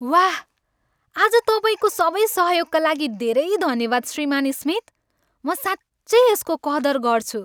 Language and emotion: Nepali, happy